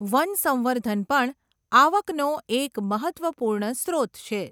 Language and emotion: Gujarati, neutral